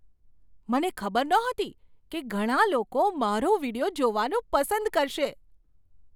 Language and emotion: Gujarati, surprised